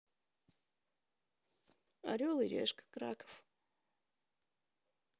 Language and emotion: Russian, neutral